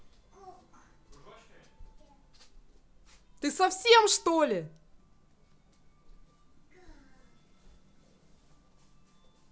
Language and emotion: Russian, angry